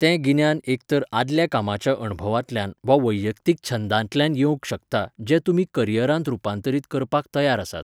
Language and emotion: Goan Konkani, neutral